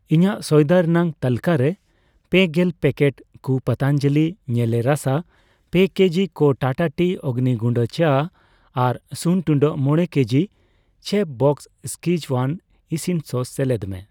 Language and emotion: Santali, neutral